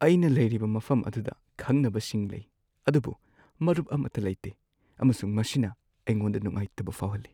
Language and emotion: Manipuri, sad